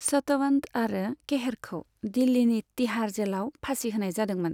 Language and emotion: Bodo, neutral